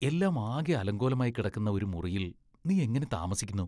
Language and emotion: Malayalam, disgusted